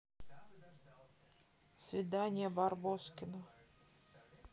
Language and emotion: Russian, neutral